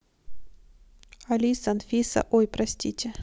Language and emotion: Russian, neutral